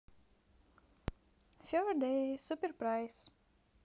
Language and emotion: Russian, positive